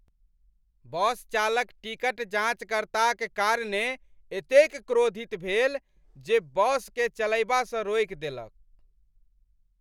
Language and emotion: Maithili, angry